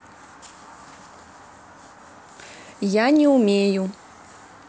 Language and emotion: Russian, neutral